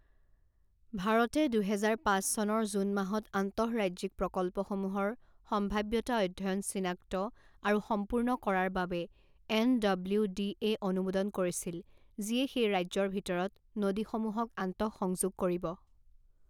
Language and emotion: Assamese, neutral